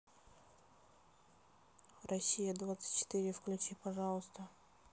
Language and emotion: Russian, neutral